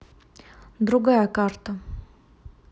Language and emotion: Russian, neutral